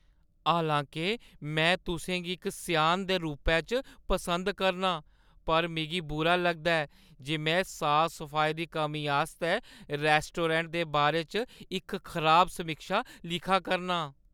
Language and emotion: Dogri, sad